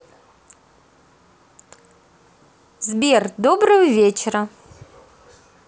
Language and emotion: Russian, positive